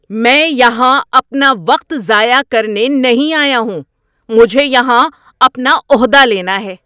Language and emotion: Urdu, angry